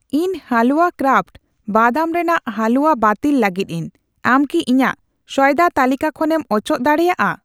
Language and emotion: Santali, neutral